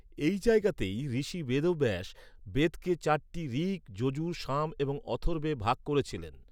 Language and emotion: Bengali, neutral